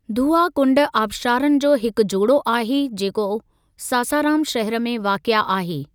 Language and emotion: Sindhi, neutral